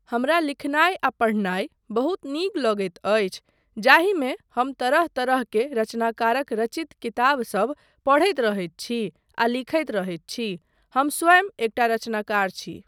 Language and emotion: Maithili, neutral